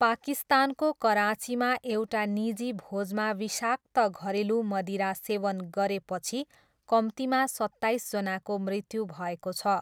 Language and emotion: Nepali, neutral